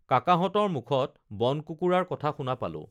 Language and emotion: Assamese, neutral